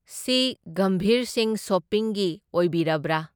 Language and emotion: Manipuri, neutral